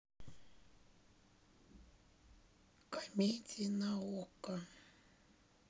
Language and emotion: Russian, sad